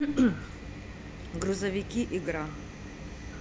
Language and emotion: Russian, neutral